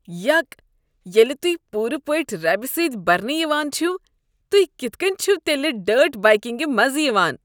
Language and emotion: Kashmiri, disgusted